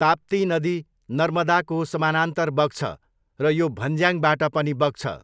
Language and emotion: Nepali, neutral